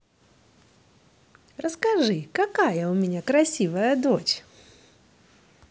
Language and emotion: Russian, positive